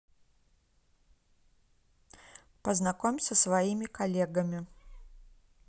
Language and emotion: Russian, neutral